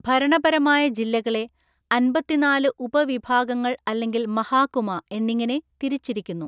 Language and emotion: Malayalam, neutral